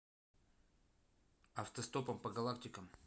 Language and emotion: Russian, neutral